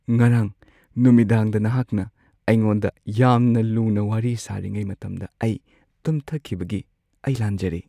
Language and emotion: Manipuri, sad